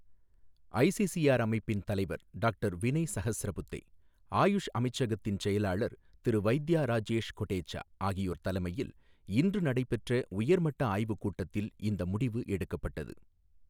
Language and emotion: Tamil, neutral